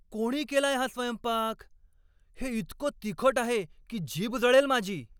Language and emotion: Marathi, angry